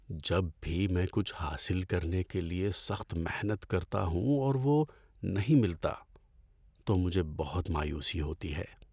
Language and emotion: Urdu, sad